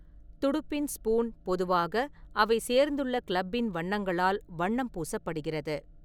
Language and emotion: Tamil, neutral